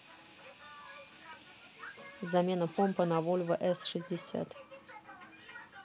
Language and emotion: Russian, neutral